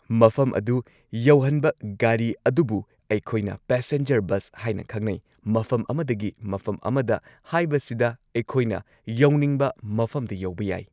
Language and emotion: Manipuri, neutral